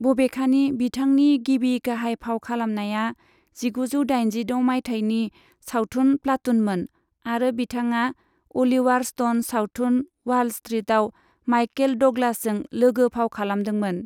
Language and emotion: Bodo, neutral